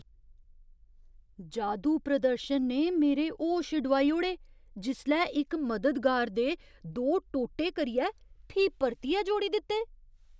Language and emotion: Dogri, surprised